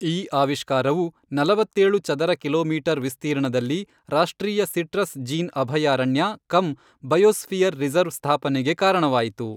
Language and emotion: Kannada, neutral